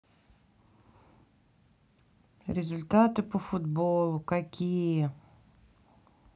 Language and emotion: Russian, sad